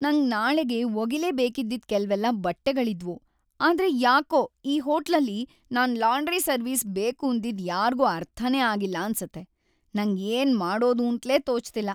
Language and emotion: Kannada, sad